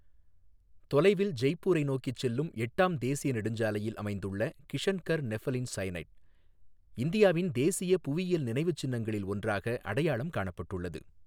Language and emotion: Tamil, neutral